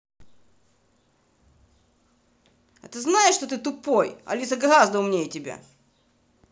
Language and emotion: Russian, angry